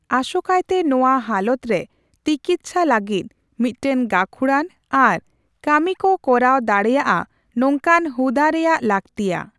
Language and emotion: Santali, neutral